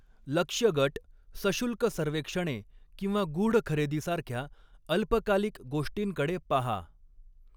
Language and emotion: Marathi, neutral